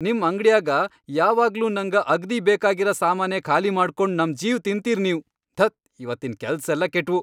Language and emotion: Kannada, angry